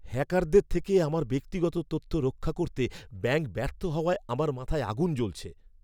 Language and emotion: Bengali, angry